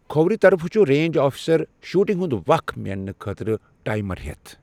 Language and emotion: Kashmiri, neutral